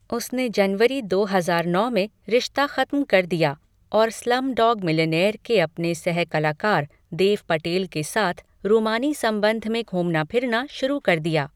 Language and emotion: Hindi, neutral